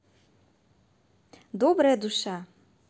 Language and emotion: Russian, positive